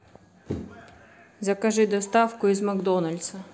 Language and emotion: Russian, neutral